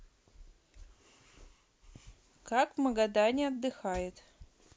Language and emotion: Russian, neutral